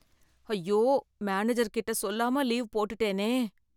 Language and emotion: Tamil, fearful